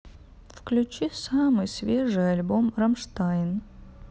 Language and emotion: Russian, sad